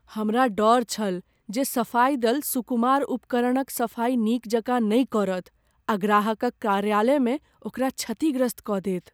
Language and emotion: Maithili, fearful